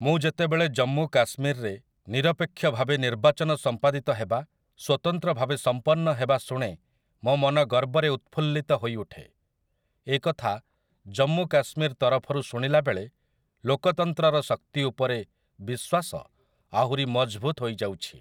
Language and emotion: Odia, neutral